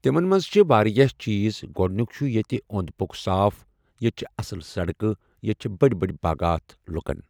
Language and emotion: Kashmiri, neutral